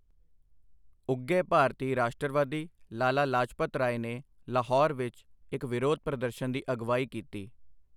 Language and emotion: Punjabi, neutral